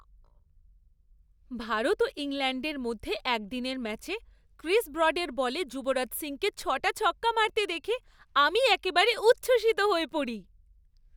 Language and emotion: Bengali, happy